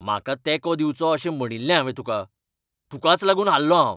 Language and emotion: Goan Konkani, angry